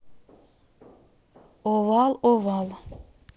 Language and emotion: Russian, neutral